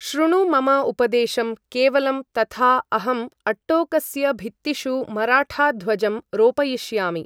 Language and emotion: Sanskrit, neutral